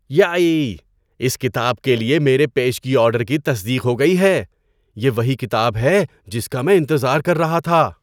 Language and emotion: Urdu, surprised